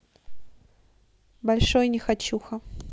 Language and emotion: Russian, neutral